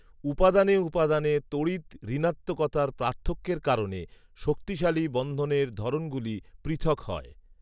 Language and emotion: Bengali, neutral